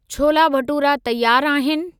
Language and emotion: Sindhi, neutral